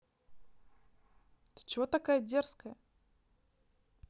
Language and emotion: Russian, neutral